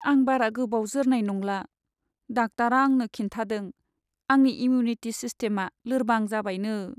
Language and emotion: Bodo, sad